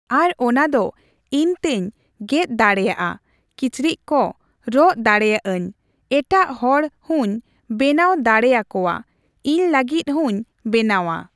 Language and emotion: Santali, neutral